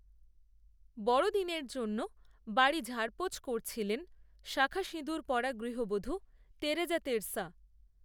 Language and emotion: Bengali, neutral